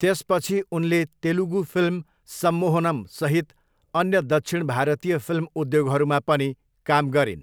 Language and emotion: Nepali, neutral